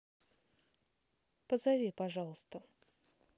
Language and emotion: Russian, neutral